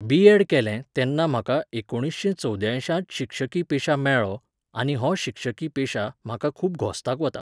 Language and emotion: Goan Konkani, neutral